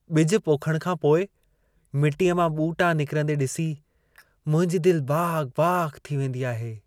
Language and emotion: Sindhi, happy